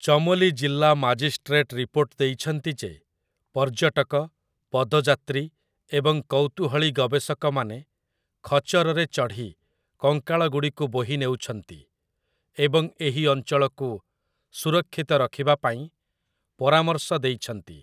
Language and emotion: Odia, neutral